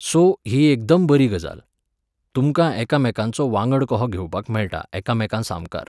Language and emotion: Goan Konkani, neutral